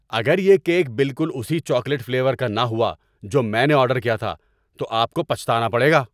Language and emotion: Urdu, angry